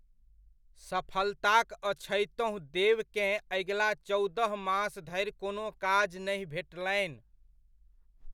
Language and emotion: Maithili, neutral